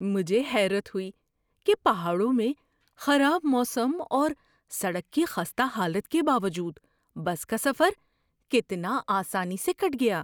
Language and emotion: Urdu, surprised